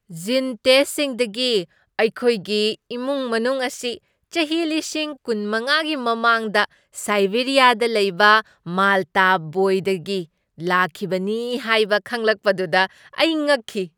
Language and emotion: Manipuri, surprised